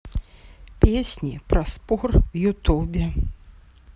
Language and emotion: Russian, neutral